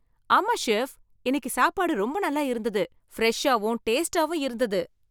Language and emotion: Tamil, happy